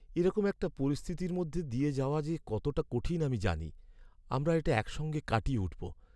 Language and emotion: Bengali, sad